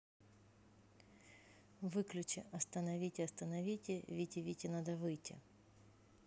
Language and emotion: Russian, neutral